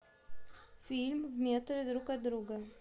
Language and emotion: Russian, neutral